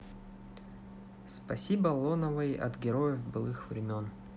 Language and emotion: Russian, neutral